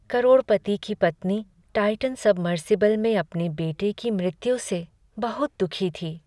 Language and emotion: Hindi, sad